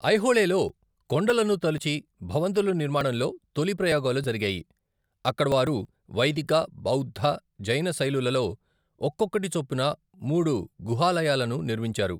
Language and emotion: Telugu, neutral